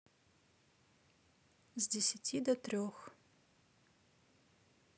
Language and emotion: Russian, neutral